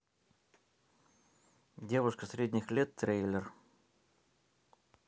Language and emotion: Russian, neutral